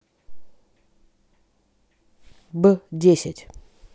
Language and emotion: Russian, neutral